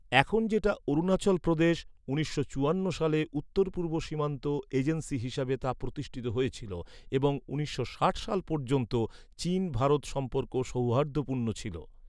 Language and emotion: Bengali, neutral